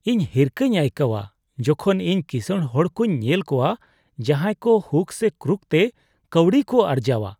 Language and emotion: Santali, disgusted